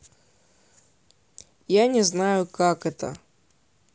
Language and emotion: Russian, neutral